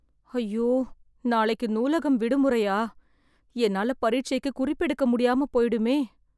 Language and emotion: Tamil, sad